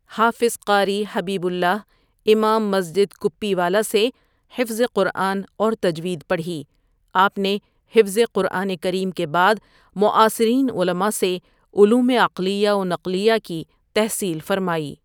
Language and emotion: Urdu, neutral